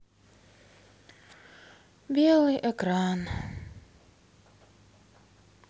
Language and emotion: Russian, sad